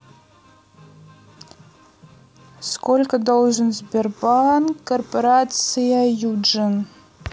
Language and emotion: Russian, neutral